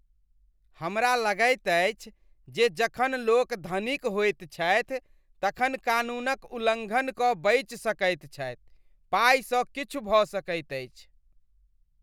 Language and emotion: Maithili, disgusted